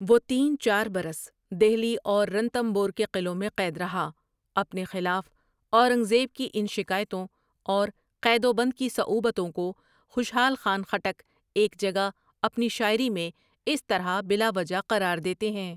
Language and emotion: Urdu, neutral